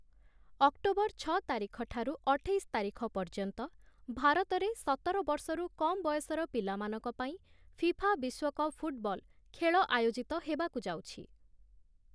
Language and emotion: Odia, neutral